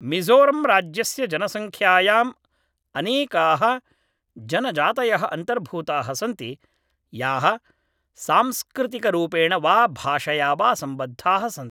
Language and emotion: Sanskrit, neutral